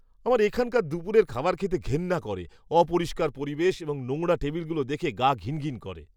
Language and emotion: Bengali, disgusted